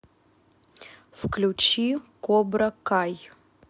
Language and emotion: Russian, neutral